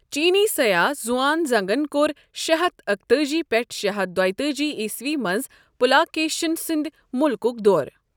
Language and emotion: Kashmiri, neutral